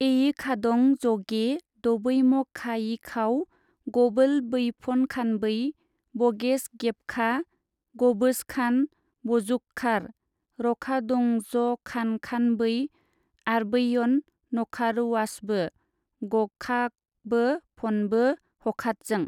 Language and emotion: Bodo, neutral